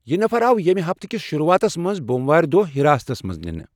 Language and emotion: Kashmiri, neutral